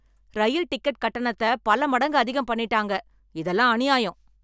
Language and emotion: Tamil, angry